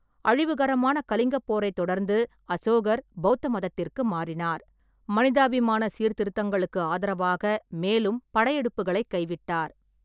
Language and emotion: Tamil, neutral